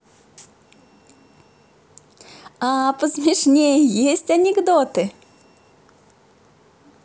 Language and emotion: Russian, positive